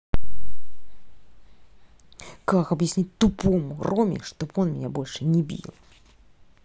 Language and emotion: Russian, angry